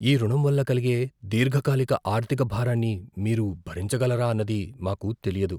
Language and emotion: Telugu, fearful